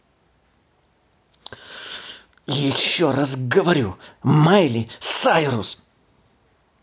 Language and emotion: Russian, angry